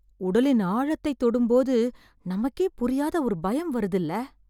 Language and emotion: Tamil, fearful